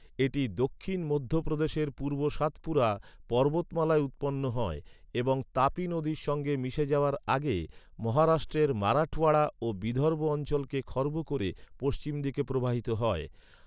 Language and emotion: Bengali, neutral